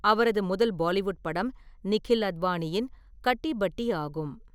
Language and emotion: Tamil, neutral